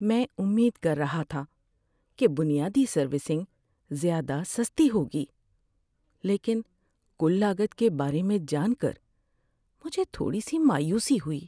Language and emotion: Urdu, sad